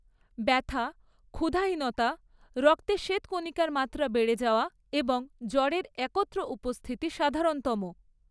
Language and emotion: Bengali, neutral